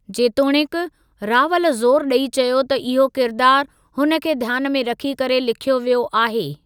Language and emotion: Sindhi, neutral